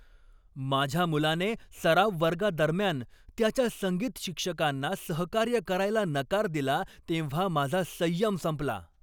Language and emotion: Marathi, angry